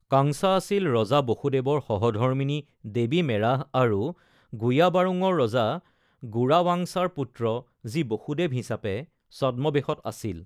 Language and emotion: Assamese, neutral